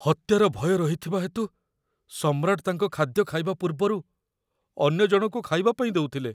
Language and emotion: Odia, fearful